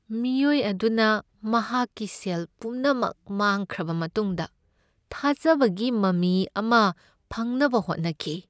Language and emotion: Manipuri, sad